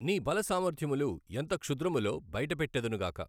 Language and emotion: Telugu, neutral